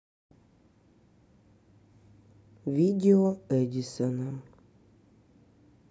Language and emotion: Russian, sad